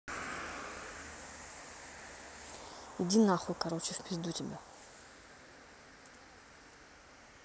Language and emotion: Russian, angry